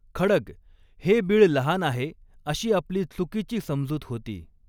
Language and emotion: Marathi, neutral